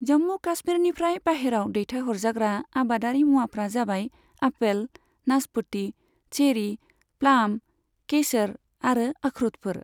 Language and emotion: Bodo, neutral